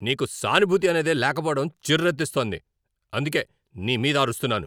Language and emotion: Telugu, angry